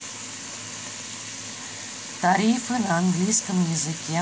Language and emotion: Russian, neutral